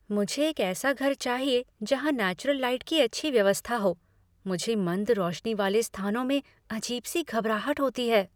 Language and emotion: Hindi, fearful